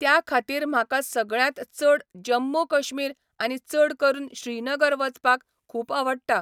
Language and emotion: Goan Konkani, neutral